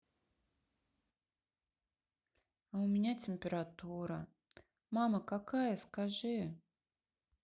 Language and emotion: Russian, sad